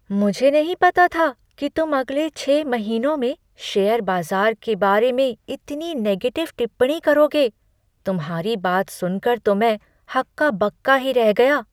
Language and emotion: Hindi, surprised